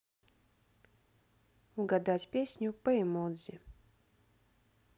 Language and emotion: Russian, neutral